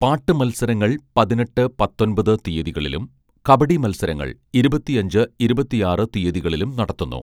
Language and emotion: Malayalam, neutral